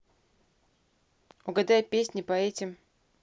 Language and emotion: Russian, neutral